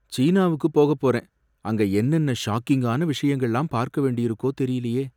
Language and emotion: Tamil, fearful